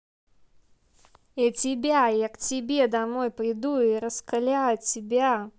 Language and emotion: Russian, angry